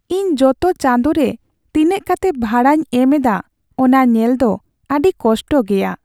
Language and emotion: Santali, sad